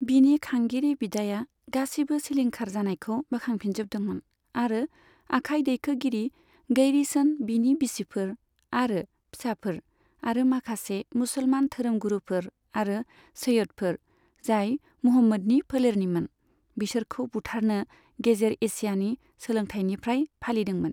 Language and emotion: Bodo, neutral